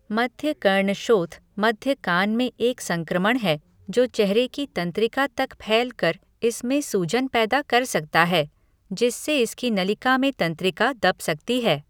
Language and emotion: Hindi, neutral